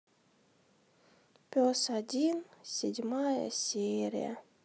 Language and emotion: Russian, sad